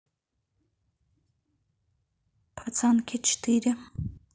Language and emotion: Russian, neutral